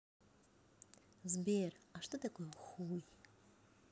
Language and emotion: Russian, positive